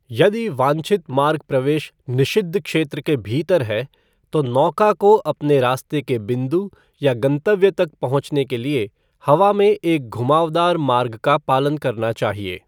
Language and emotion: Hindi, neutral